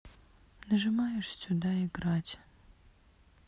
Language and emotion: Russian, sad